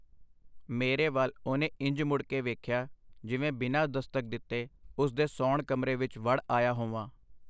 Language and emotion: Punjabi, neutral